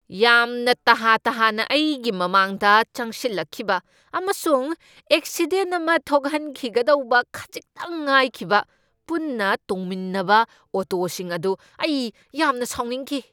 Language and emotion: Manipuri, angry